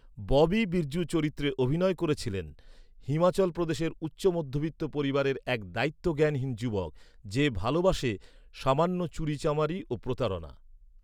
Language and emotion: Bengali, neutral